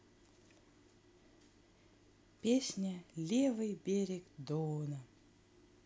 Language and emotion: Russian, neutral